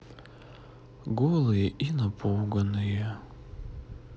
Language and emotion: Russian, neutral